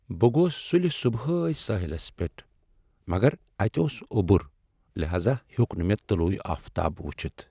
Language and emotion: Kashmiri, sad